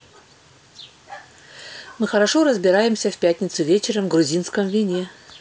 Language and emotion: Russian, neutral